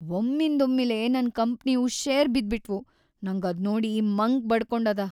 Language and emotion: Kannada, sad